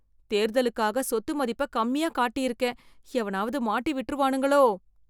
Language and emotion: Tamil, fearful